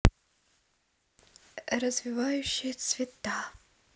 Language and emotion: Russian, neutral